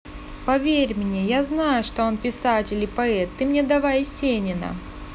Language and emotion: Russian, positive